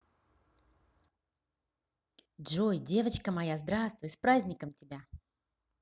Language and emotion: Russian, positive